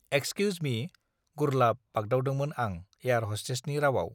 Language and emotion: Bodo, neutral